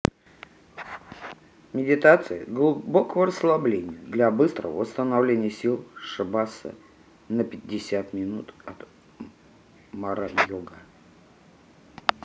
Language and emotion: Russian, neutral